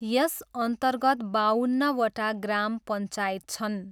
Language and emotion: Nepali, neutral